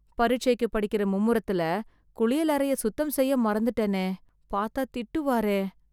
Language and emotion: Tamil, fearful